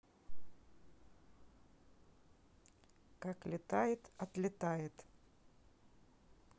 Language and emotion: Russian, neutral